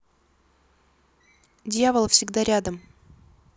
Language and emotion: Russian, neutral